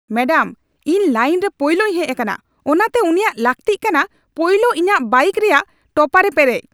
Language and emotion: Santali, angry